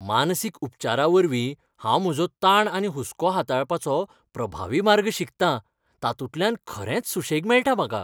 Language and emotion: Goan Konkani, happy